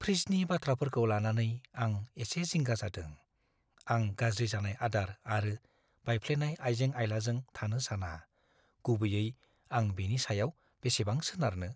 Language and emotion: Bodo, fearful